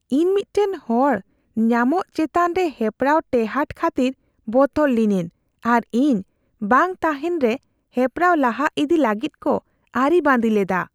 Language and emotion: Santali, fearful